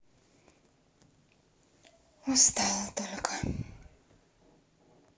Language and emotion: Russian, sad